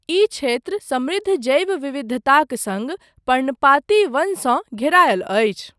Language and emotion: Maithili, neutral